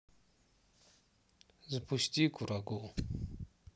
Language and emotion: Russian, sad